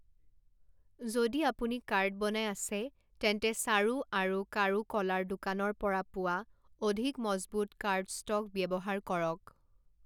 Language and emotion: Assamese, neutral